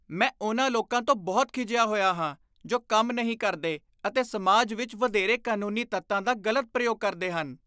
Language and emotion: Punjabi, disgusted